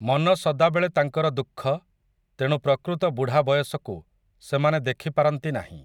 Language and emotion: Odia, neutral